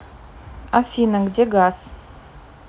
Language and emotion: Russian, neutral